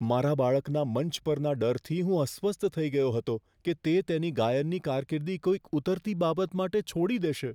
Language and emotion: Gujarati, fearful